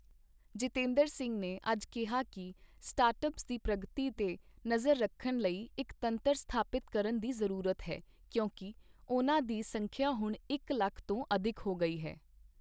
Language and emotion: Punjabi, neutral